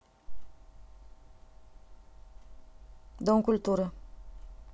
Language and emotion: Russian, neutral